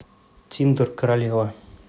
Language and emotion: Russian, neutral